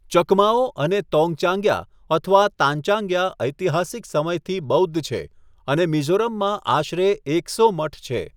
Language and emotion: Gujarati, neutral